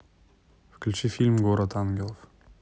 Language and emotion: Russian, neutral